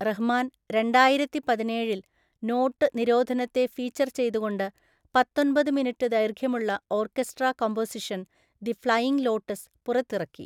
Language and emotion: Malayalam, neutral